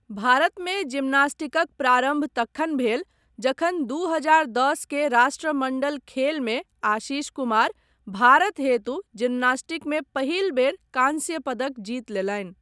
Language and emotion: Maithili, neutral